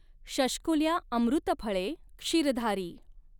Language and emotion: Marathi, neutral